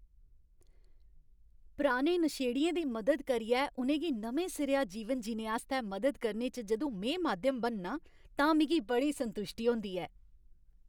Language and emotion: Dogri, happy